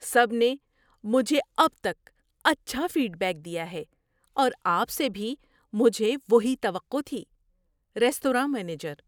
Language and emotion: Urdu, surprised